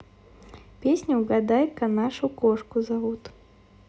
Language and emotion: Russian, neutral